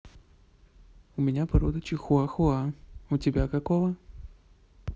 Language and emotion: Russian, neutral